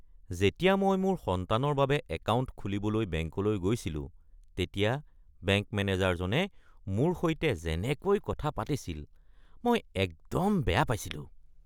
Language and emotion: Assamese, disgusted